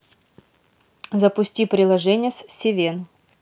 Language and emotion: Russian, neutral